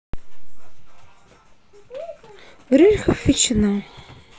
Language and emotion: Russian, sad